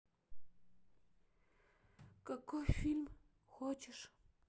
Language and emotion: Russian, sad